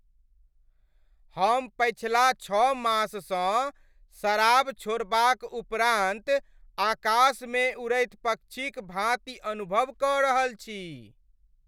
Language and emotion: Maithili, happy